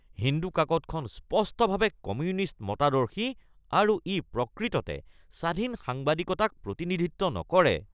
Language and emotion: Assamese, disgusted